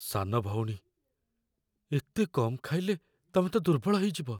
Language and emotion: Odia, fearful